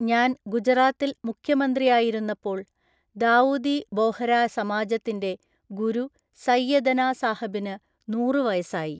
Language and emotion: Malayalam, neutral